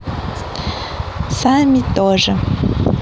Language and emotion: Russian, neutral